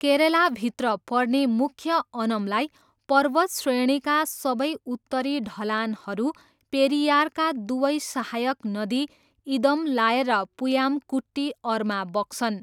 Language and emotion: Nepali, neutral